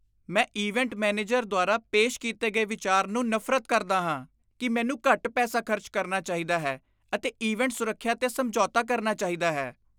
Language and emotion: Punjabi, disgusted